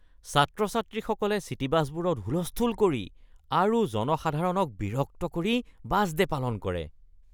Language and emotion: Assamese, disgusted